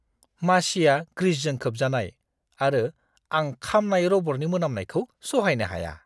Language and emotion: Bodo, disgusted